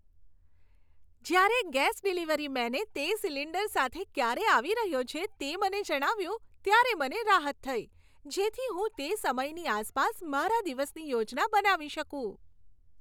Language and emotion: Gujarati, happy